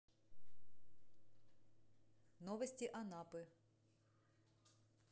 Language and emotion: Russian, neutral